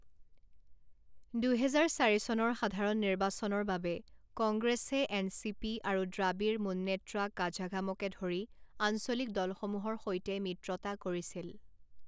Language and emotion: Assamese, neutral